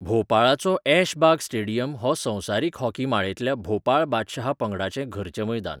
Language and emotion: Goan Konkani, neutral